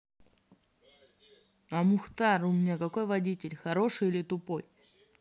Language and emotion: Russian, neutral